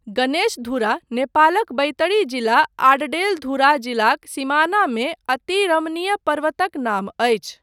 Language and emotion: Maithili, neutral